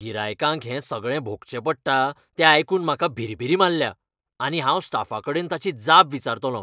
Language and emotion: Goan Konkani, angry